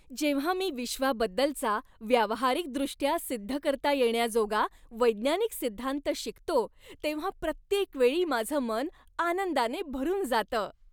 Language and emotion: Marathi, happy